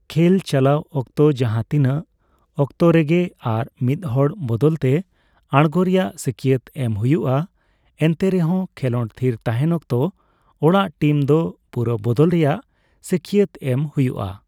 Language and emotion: Santali, neutral